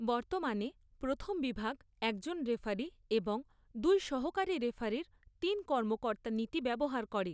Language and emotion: Bengali, neutral